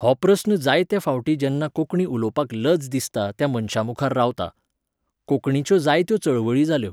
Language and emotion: Goan Konkani, neutral